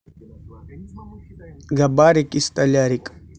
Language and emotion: Russian, positive